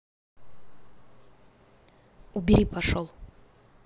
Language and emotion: Russian, neutral